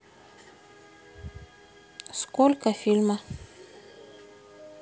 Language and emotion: Russian, neutral